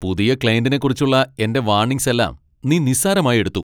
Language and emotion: Malayalam, angry